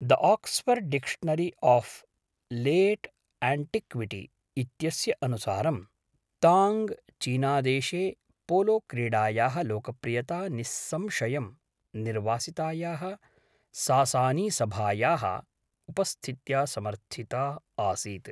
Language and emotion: Sanskrit, neutral